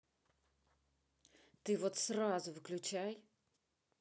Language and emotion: Russian, angry